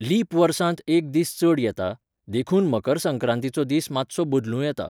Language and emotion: Goan Konkani, neutral